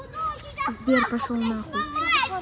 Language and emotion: Russian, angry